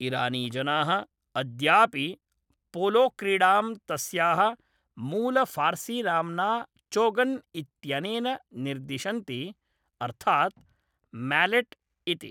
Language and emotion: Sanskrit, neutral